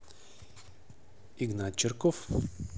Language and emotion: Russian, neutral